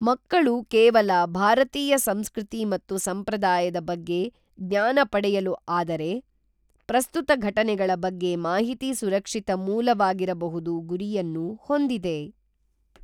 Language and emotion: Kannada, neutral